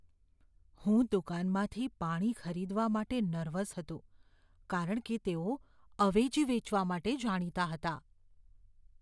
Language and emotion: Gujarati, fearful